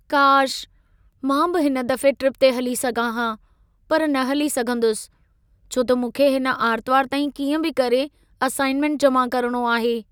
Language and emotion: Sindhi, sad